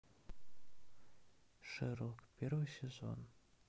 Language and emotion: Russian, sad